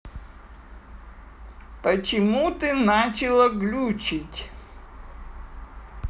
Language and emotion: Russian, neutral